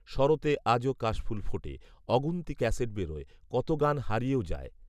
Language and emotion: Bengali, neutral